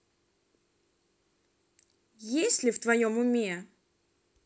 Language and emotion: Russian, neutral